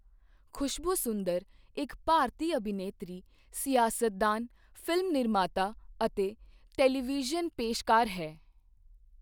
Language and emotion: Punjabi, neutral